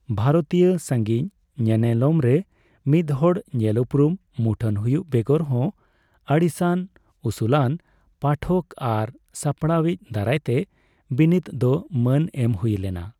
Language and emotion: Santali, neutral